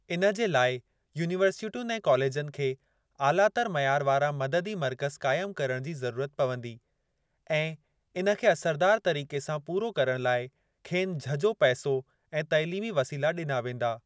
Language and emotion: Sindhi, neutral